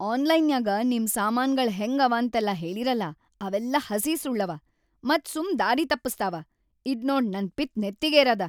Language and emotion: Kannada, angry